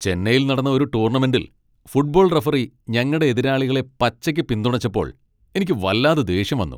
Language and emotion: Malayalam, angry